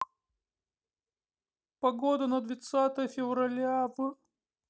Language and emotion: Russian, sad